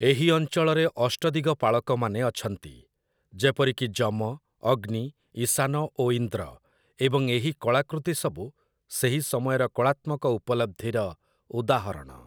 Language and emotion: Odia, neutral